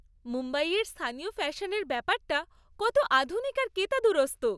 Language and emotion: Bengali, happy